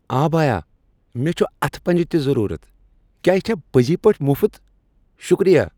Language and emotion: Kashmiri, happy